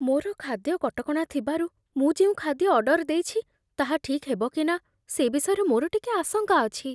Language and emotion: Odia, fearful